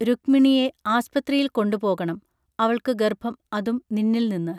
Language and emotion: Malayalam, neutral